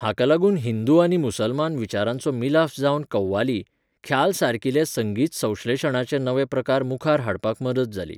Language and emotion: Goan Konkani, neutral